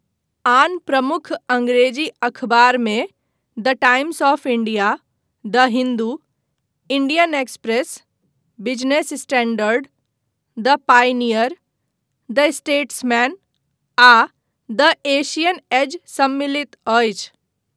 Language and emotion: Maithili, neutral